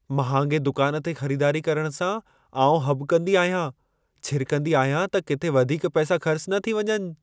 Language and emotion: Sindhi, fearful